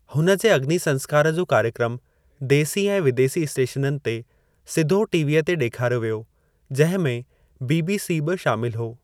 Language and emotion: Sindhi, neutral